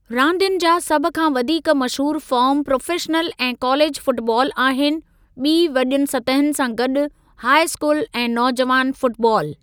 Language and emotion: Sindhi, neutral